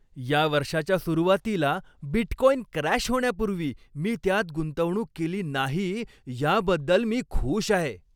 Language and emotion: Marathi, happy